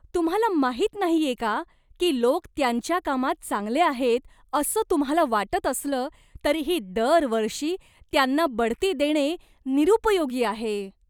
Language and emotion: Marathi, disgusted